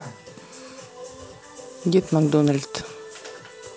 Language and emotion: Russian, neutral